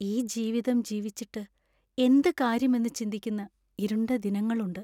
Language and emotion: Malayalam, sad